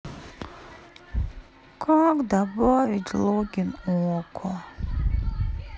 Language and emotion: Russian, sad